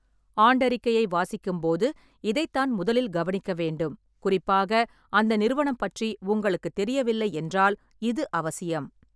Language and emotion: Tamil, neutral